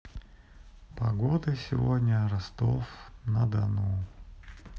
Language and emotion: Russian, sad